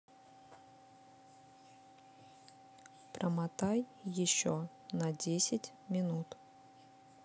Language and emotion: Russian, neutral